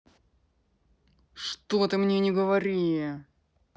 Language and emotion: Russian, angry